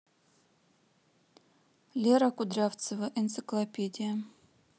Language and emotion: Russian, neutral